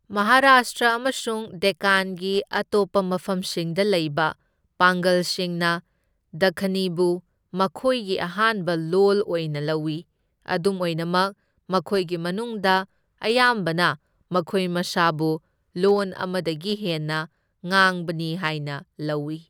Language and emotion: Manipuri, neutral